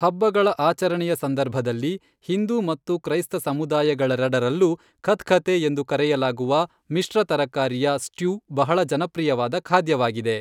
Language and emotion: Kannada, neutral